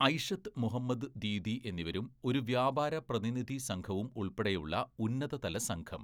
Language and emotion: Malayalam, neutral